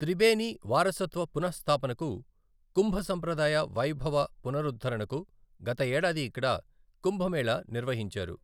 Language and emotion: Telugu, neutral